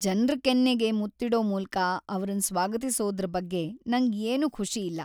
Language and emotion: Kannada, sad